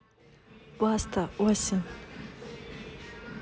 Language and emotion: Russian, neutral